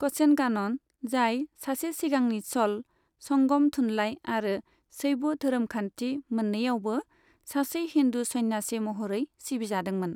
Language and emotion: Bodo, neutral